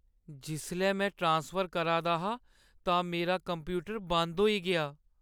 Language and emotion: Dogri, sad